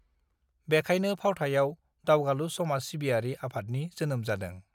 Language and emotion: Bodo, neutral